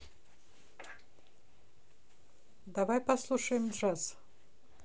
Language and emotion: Russian, neutral